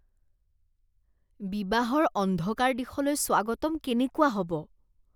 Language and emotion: Assamese, disgusted